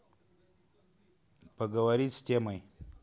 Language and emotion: Russian, neutral